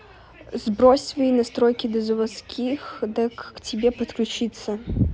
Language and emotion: Russian, neutral